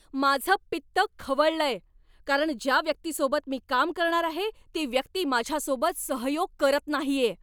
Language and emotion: Marathi, angry